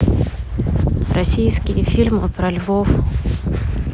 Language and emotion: Russian, neutral